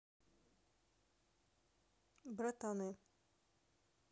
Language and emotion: Russian, neutral